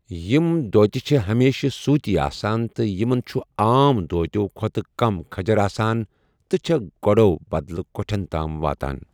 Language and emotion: Kashmiri, neutral